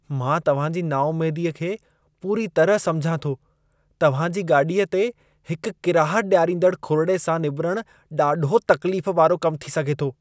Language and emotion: Sindhi, disgusted